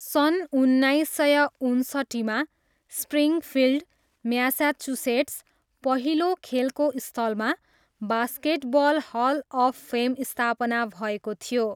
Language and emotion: Nepali, neutral